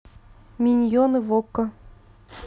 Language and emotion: Russian, neutral